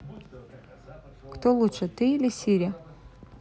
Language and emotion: Russian, neutral